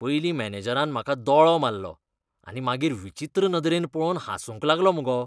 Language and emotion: Goan Konkani, disgusted